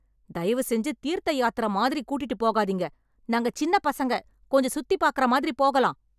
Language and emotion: Tamil, angry